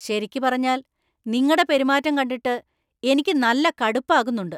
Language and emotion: Malayalam, angry